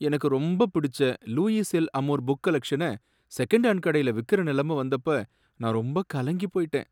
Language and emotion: Tamil, sad